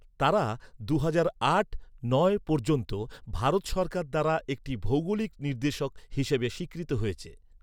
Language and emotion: Bengali, neutral